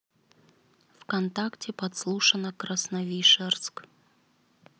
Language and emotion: Russian, neutral